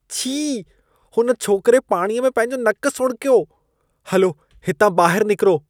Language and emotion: Sindhi, disgusted